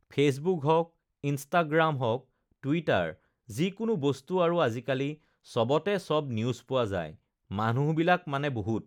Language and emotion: Assamese, neutral